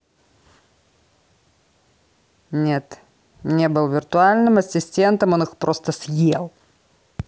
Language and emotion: Russian, angry